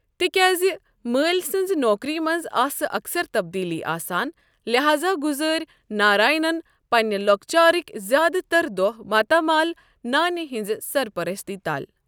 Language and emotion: Kashmiri, neutral